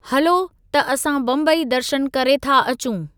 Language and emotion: Sindhi, neutral